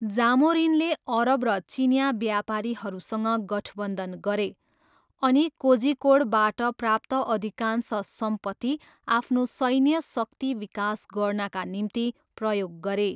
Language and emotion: Nepali, neutral